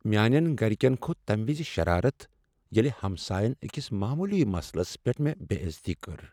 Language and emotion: Kashmiri, sad